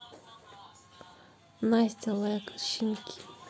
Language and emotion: Russian, neutral